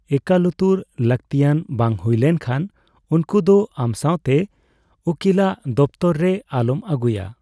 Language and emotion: Santali, neutral